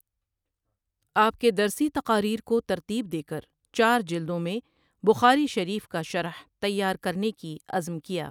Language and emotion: Urdu, neutral